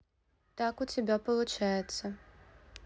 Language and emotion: Russian, neutral